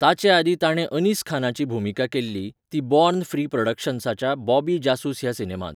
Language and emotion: Goan Konkani, neutral